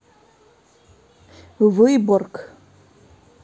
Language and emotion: Russian, neutral